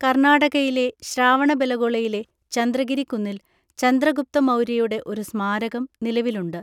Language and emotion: Malayalam, neutral